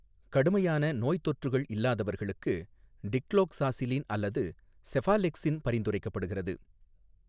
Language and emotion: Tamil, neutral